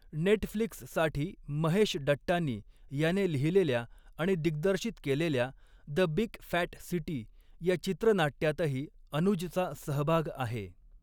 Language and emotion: Marathi, neutral